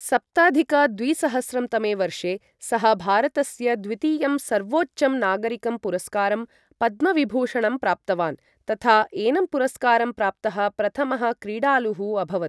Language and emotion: Sanskrit, neutral